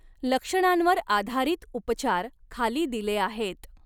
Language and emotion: Marathi, neutral